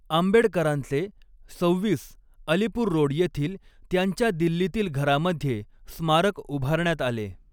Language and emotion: Marathi, neutral